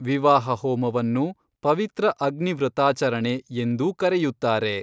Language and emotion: Kannada, neutral